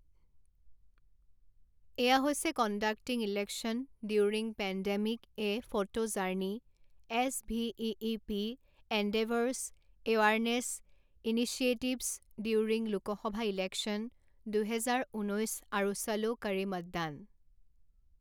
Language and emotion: Assamese, neutral